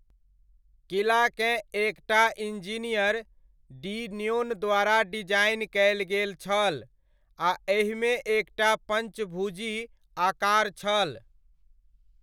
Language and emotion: Maithili, neutral